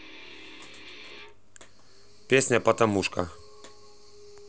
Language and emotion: Russian, neutral